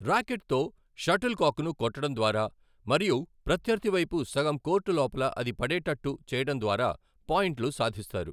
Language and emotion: Telugu, neutral